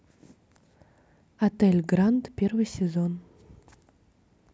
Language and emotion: Russian, neutral